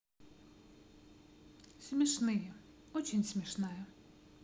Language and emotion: Russian, positive